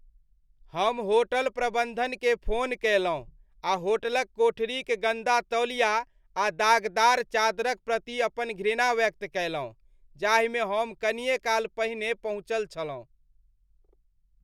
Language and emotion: Maithili, disgusted